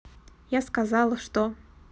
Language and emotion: Russian, neutral